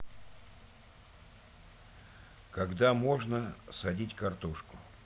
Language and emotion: Russian, neutral